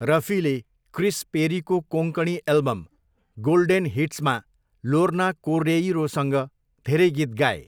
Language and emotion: Nepali, neutral